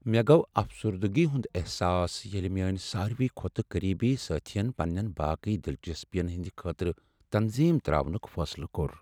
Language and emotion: Kashmiri, sad